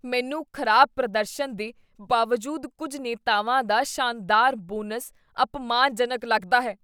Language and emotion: Punjabi, disgusted